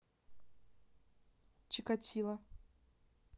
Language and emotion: Russian, neutral